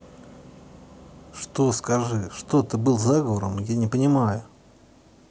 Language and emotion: Russian, angry